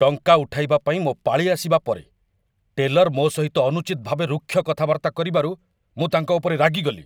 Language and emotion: Odia, angry